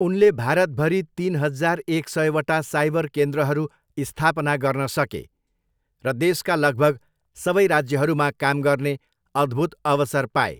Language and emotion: Nepali, neutral